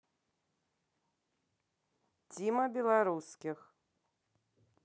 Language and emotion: Russian, neutral